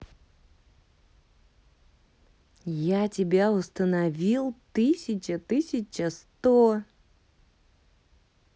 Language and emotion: Russian, positive